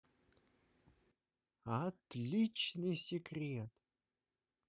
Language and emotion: Russian, positive